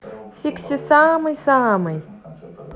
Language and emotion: Russian, positive